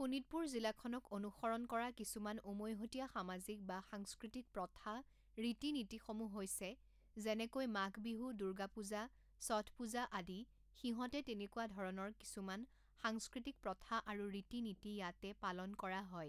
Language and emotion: Assamese, neutral